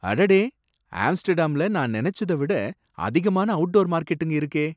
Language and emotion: Tamil, surprised